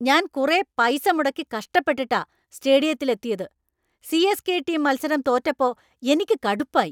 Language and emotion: Malayalam, angry